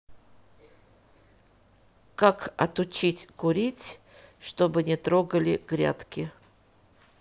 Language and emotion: Russian, neutral